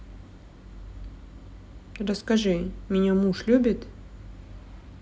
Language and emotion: Russian, neutral